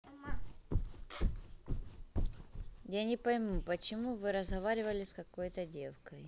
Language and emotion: Russian, neutral